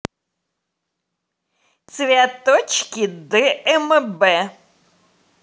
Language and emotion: Russian, positive